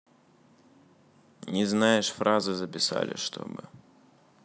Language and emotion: Russian, neutral